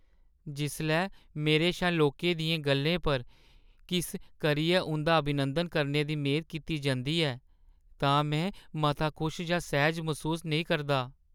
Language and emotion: Dogri, sad